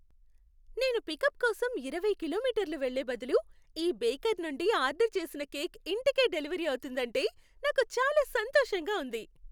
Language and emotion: Telugu, happy